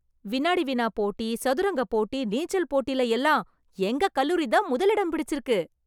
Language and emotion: Tamil, happy